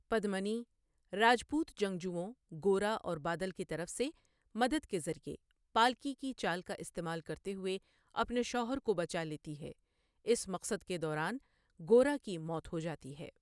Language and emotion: Urdu, neutral